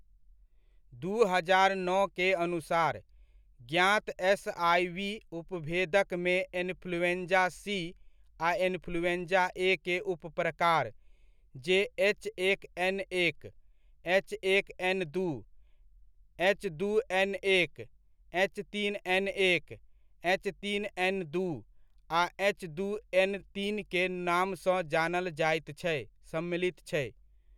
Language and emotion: Maithili, neutral